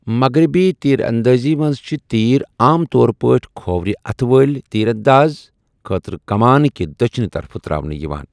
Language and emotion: Kashmiri, neutral